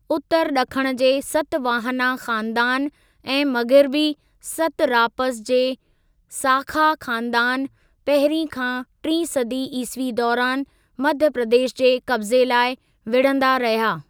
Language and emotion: Sindhi, neutral